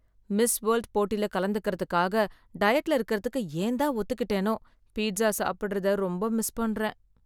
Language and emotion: Tamil, sad